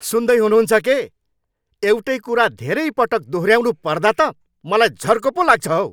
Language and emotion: Nepali, angry